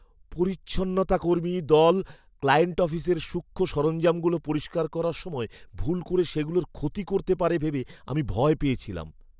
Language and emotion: Bengali, fearful